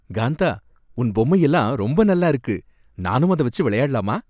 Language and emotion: Tamil, happy